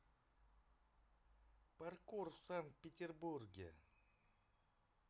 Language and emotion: Russian, neutral